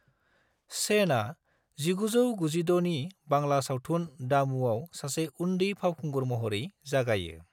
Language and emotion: Bodo, neutral